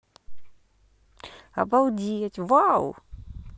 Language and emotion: Russian, positive